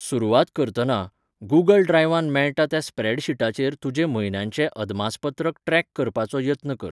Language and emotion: Goan Konkani, neutral